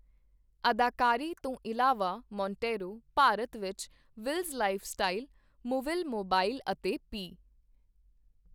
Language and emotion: Punjabi, neutral